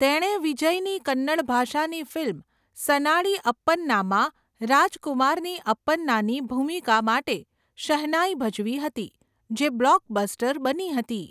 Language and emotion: Gujarati, neutral